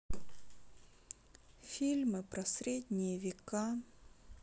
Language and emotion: Russian, sad